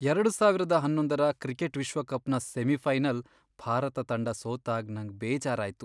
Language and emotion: Kannada, sad